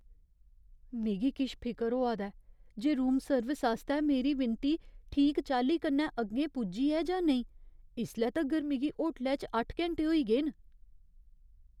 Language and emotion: Dogri, fearful